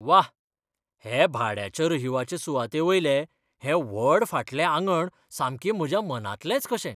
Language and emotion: Goan Konkani, surprised